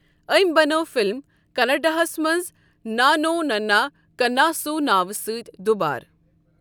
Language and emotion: Kashmiri, neutral